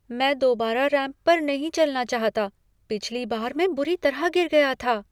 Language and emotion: Hindi, fearful